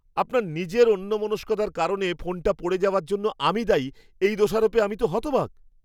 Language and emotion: Bengali, surprised